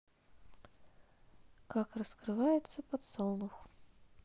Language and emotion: Russian, neutral